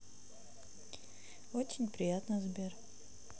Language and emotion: Russian, neutral